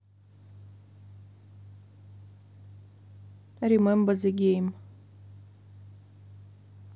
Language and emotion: Russian, neutral